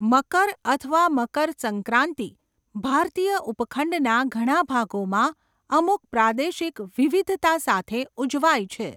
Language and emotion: Gujarati, neutral